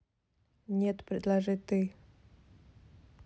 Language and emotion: Russian, neutral